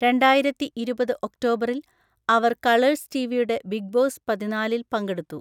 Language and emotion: Malayalam, neutral